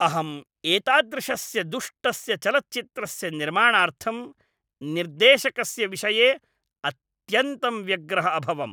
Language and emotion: Sanskrit, angry